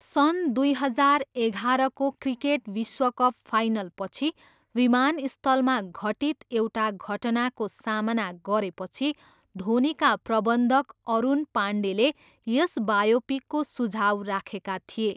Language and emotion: Nepali, neutral